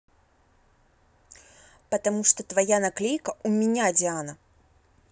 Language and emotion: Russian, angry